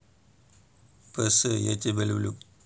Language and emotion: Russian, neutral